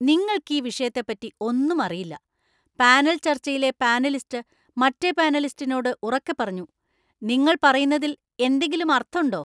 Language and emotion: Malayalam, angry